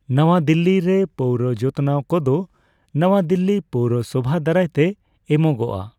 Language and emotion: Santali, neutral